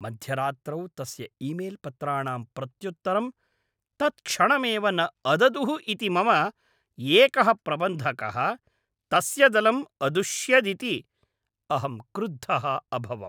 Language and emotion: Sanskrit, angry